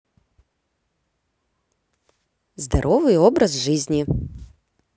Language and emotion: Russian, positive